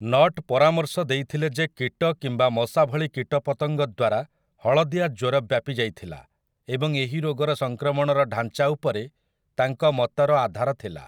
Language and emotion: Odia, neutral